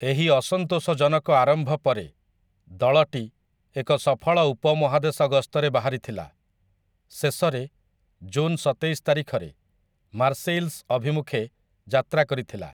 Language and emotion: Odia, neutral